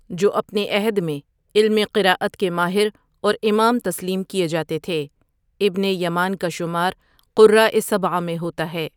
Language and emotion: Urdu, neutral